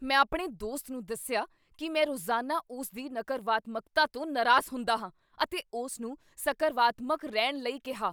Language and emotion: Punjabi, angry